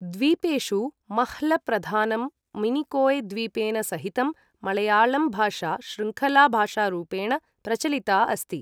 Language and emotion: Sanskrit, neutral